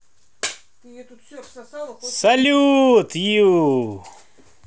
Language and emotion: Russian, positive